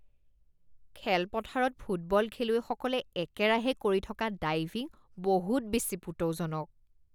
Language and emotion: Assamese, disgusted